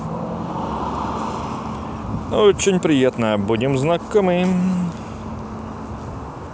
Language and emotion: Russian, positive